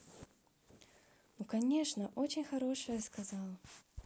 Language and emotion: Russian, positive